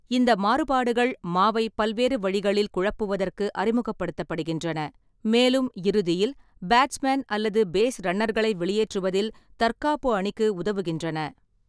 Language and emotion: Tamil, neutral